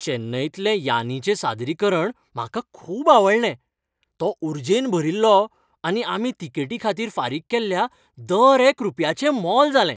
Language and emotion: Goan Konkani, happy